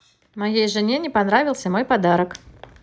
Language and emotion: Russian, positive